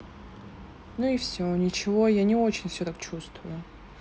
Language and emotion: Russian, neutral